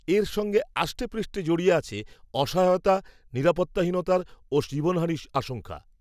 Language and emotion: Bengali, neutral